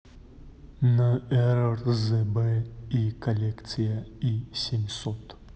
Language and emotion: Russian, neutral